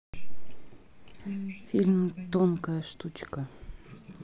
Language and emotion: Russian, neutral